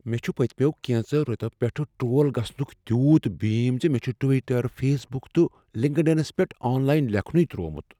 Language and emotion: Kashmiri, fearful